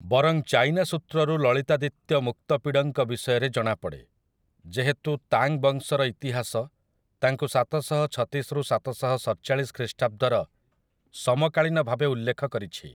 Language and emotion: Odia, neutral